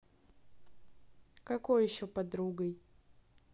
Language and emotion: Russian, neutral